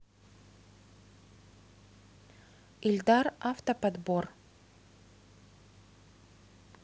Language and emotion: Russian, neutral